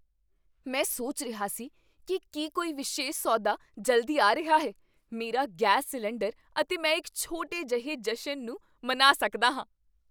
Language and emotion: Punjabi, surprised